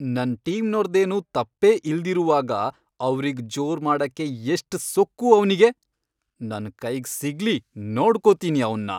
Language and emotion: Kannada, angry